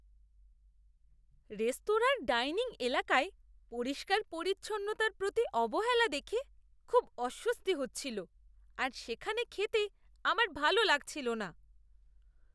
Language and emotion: Bengali, disgusted